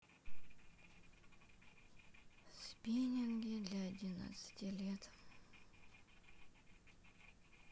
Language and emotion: Russian, sad